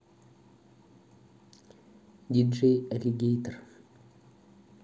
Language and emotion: Russian, neutral